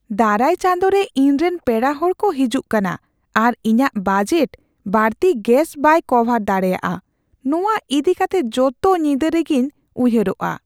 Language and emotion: Santali, fearful